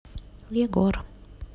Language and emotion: Russian, neutral